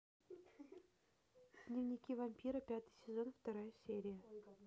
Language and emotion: Russian, neutral